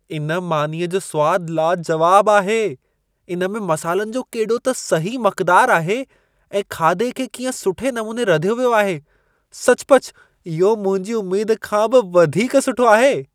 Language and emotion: Sindhi, surprised